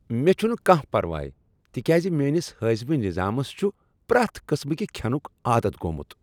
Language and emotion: Kashmiri, happy